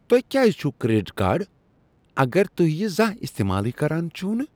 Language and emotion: Kashmiri, disgusted